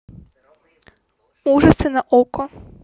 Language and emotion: Russian, neutral